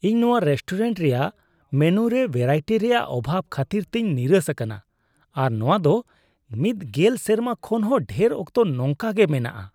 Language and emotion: Santali, disgusted